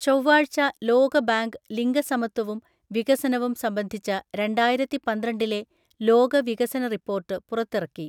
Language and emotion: Malayalam, neutral